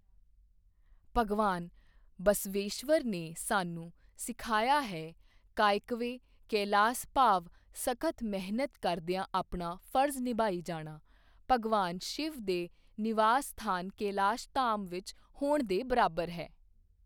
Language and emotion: Punjabi, neutral